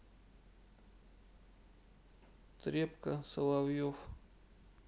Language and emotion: Russian, sad